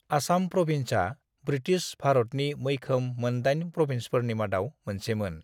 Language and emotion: Bodo, neutral